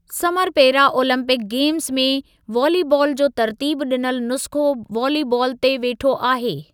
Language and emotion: Sindhi, neutral